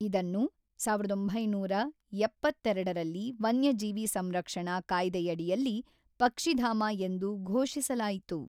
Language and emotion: Kannada, neutral